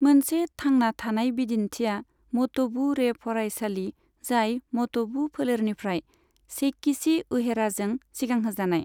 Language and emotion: Bodo, neutral